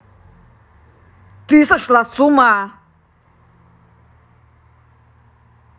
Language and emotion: Russian, angry